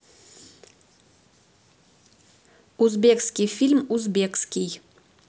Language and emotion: Russian, neutral